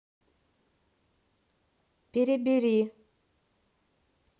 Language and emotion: Russian, neutral